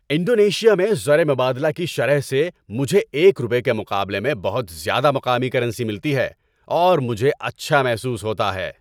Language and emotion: Urdu, happy